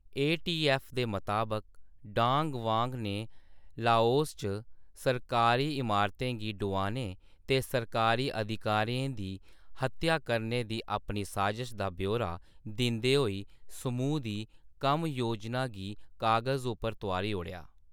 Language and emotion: Dogri, neutral